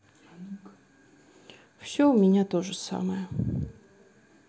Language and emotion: Russian, sad